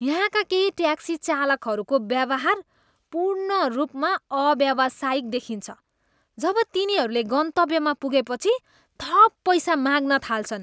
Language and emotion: Nepali, disgusted